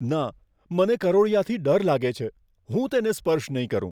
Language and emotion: Gujarati, fearful